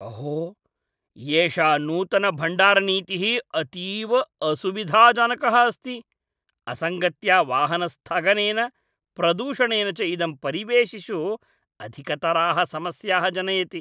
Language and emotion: Sanskrit, disgusted